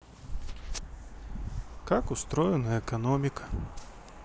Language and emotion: Russian, neutral